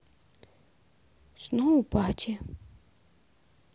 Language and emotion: Russian, sad